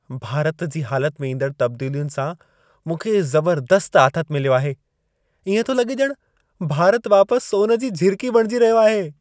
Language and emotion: Sindhi, happy